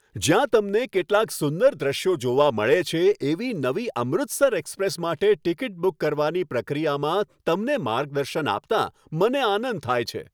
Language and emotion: Gujarati, happy